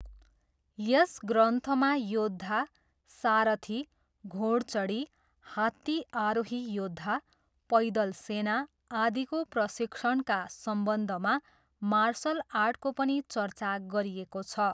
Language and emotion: Nepali, neutral